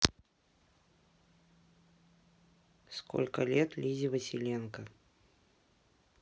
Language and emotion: Russian, neutral